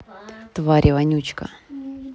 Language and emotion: Russian, neutral